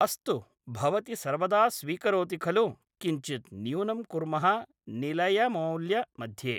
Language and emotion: Sanskrit, neutral